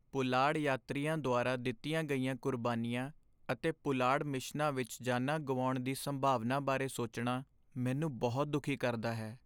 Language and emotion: Punjabi, sad